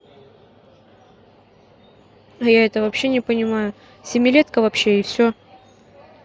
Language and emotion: Russian, neutral